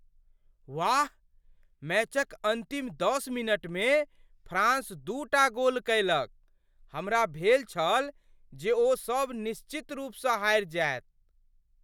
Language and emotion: Maithili, surprised